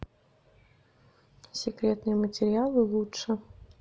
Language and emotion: Russian, neutral